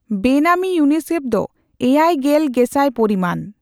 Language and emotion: Santali, neutral